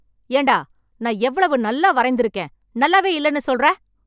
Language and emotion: Tamil, angry